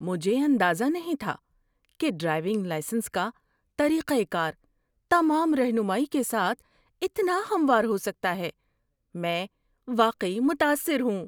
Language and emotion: Urdu, surprised